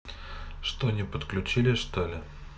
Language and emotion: Russian, neutral